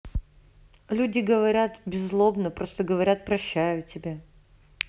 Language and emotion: Russian, neutral